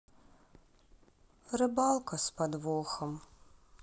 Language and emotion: Russian, sad